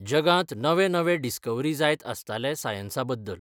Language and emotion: Goan Konkani, neutral